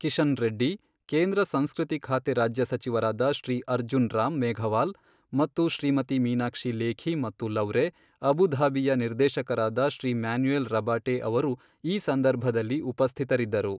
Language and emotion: Kannada, neutral